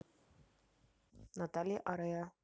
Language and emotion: Russian, neutral